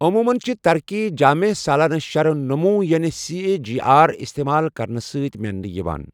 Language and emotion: Kashmiri, neutral